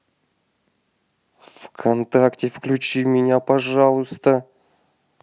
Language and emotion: Russian, angry